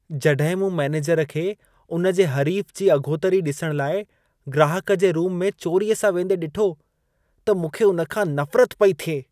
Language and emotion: Sindhi, disgusted